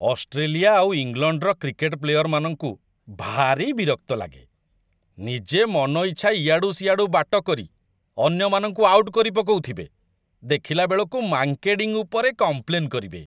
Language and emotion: Odia, disgusted